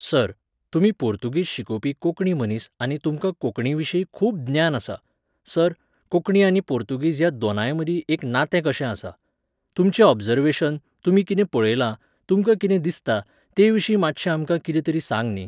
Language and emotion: Goan Konkani, neutral